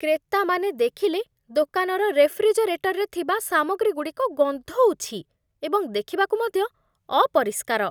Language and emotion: Odia, disgusted